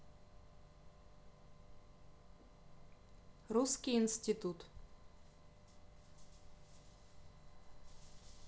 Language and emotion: Russian, neutral